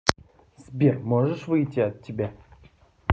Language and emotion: Russian, neutral